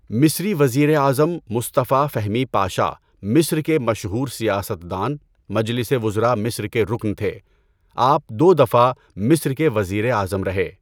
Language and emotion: Urdu, neutral